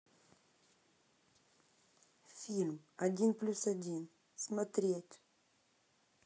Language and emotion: Russian, neutral